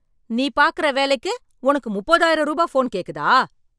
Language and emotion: Tamil, angry